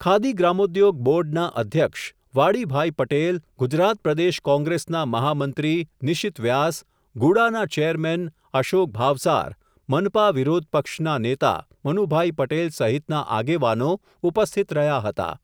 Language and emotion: Gujarati, neutral